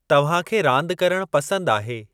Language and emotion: Sindhi, neutral